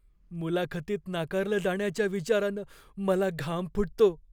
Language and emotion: Marathi, fearful